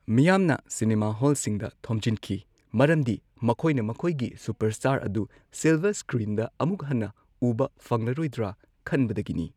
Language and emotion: Manipuri, neutral